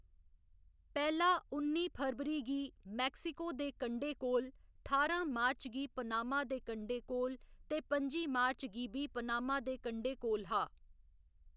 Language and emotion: Dogri, neutral